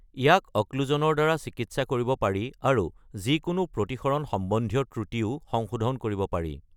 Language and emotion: Assamese, neutral